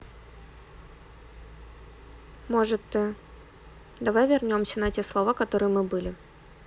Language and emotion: Russian, neutral